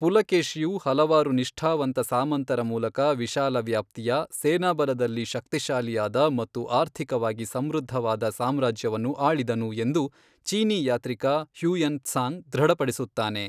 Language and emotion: Kannada, neutral